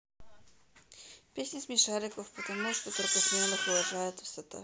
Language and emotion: Russian, neutral